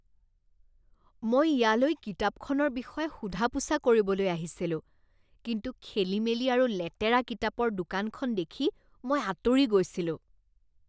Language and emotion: Assamese, disgusted